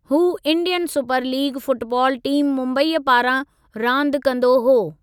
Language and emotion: Sindhi, neutral